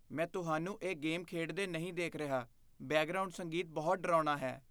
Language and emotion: Punjabi, fearful